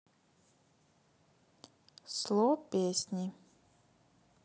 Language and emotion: Russian, neutral